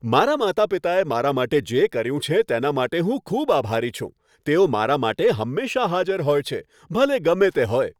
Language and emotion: Gujarati, happy